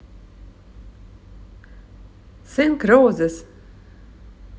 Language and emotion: Russian, positive